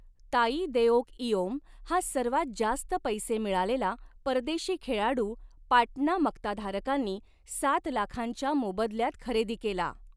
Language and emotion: Marathi, neutral